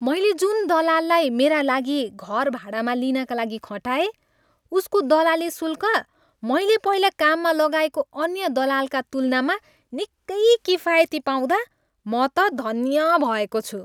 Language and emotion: Nepali, happy